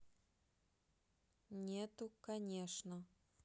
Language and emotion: Russian, neutral